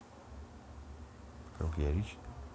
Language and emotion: Russian, neutral